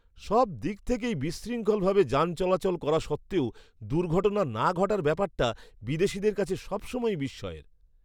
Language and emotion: Bengali, surprised